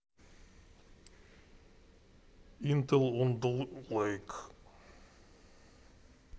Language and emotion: Russian, neutral